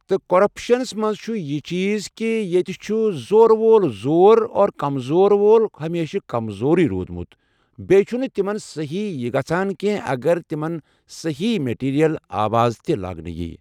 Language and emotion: Kashmiri, neutral